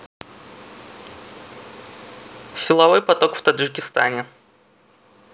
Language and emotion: Russian, neutral